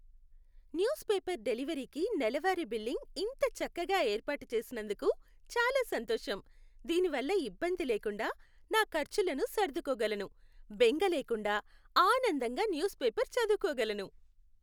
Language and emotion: Telugu, happy